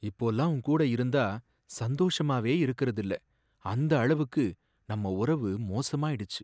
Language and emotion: Tamil, sad